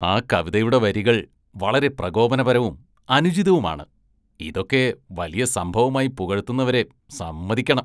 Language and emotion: Malayalam, disgusted